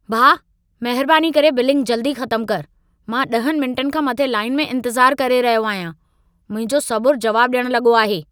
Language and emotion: Sindhi, angry